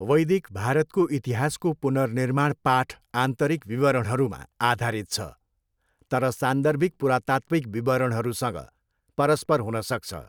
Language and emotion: Nepali, neutral